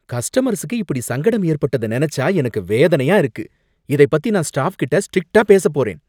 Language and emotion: Tamil, angry